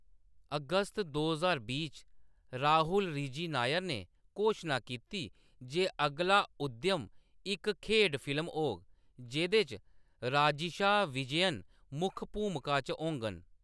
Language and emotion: Dogri, neutral